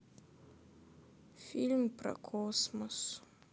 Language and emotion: Russian, sad